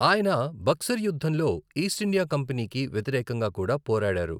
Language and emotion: Telugu, neutral